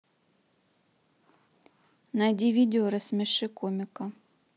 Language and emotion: Russian, neutral